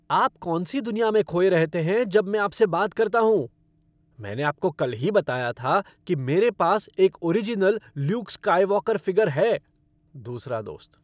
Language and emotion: Hindi, angry